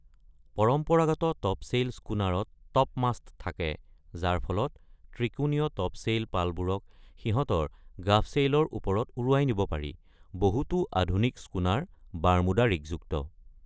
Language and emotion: Assamese, neutral